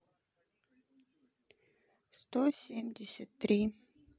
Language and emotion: Russian, neutral